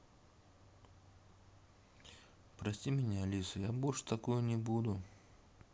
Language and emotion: Russian, sad